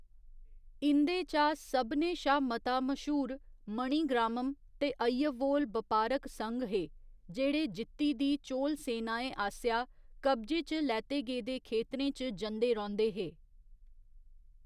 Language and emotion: Dogri, neutral